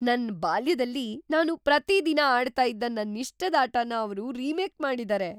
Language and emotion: Kannada, surprised